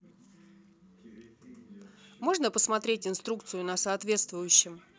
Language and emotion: Russian, neutral